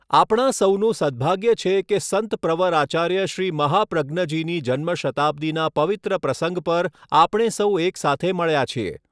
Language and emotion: Gujarati, neutral